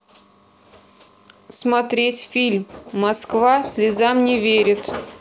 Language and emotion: Russian, neutral